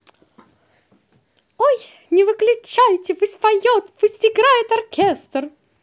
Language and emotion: Russian, positive